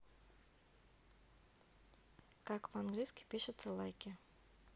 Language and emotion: Russian, neutral